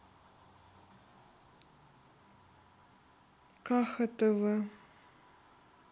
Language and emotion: Russian, sad